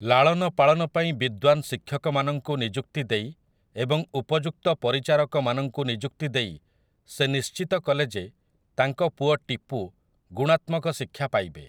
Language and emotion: Odia, neutral